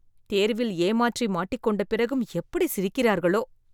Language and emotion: Tamil, disgusted